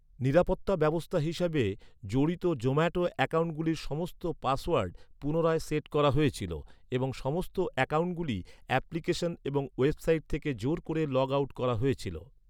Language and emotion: Bengali, neutral